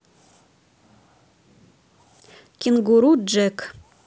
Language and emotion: Russian, neutral